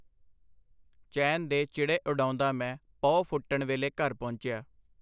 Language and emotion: Punjabi, neutral